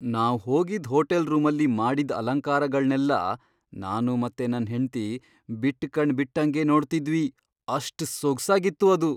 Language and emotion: Kannada, surprised